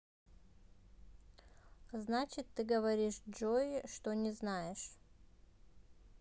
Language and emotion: Russian, neutral